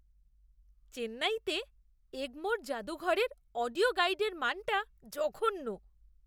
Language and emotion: Bengali, disgusted